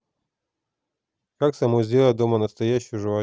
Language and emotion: Russian, neutral